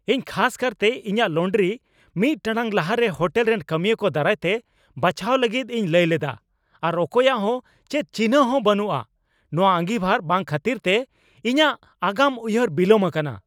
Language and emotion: Santali, angry